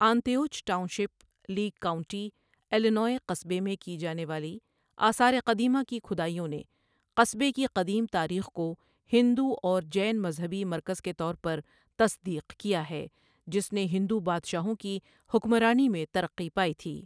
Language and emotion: Urdu, neutral